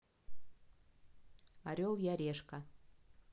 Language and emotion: Russian, neutral